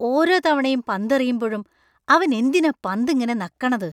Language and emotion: Malayalam, disgusted